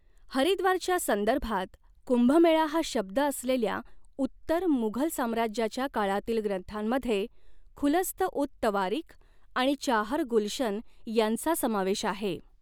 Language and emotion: Marathi, neutral